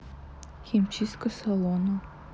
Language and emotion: Russian, neutral